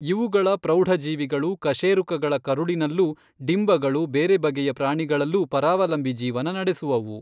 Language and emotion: Kannada, neutral